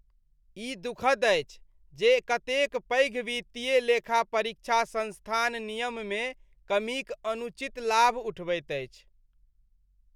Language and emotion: Maithili, disgusted